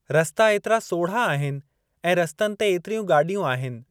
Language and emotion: Sindhi, neutral